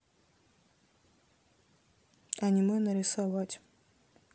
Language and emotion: Russian, neutral